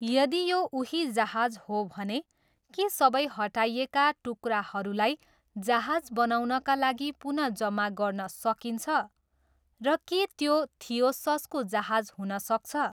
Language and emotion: Nepali, neutral